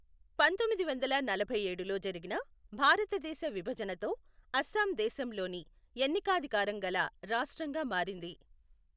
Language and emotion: Telugu, neutral